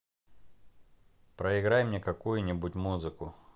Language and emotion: Russian, neutral